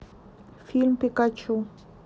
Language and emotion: Russian, neutral